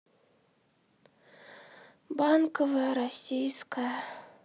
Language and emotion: Russian, sad